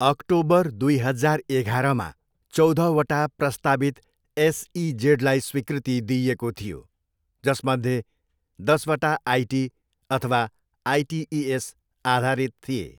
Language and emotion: Nepali, neutral